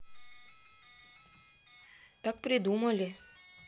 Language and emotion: Russian, neutral